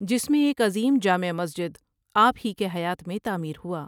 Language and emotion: Urdu, neutral